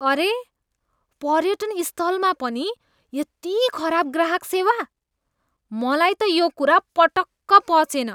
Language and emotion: Nepali, disgusted